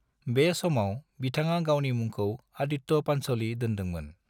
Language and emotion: Bodo, neutral